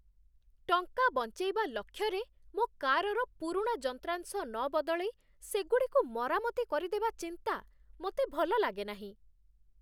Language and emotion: Odia, disgusted